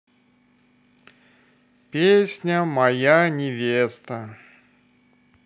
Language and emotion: Russian, sad